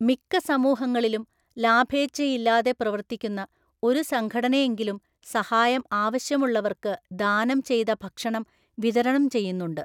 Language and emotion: Malayalam, neutral